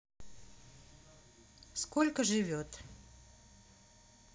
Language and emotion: Russian, neutral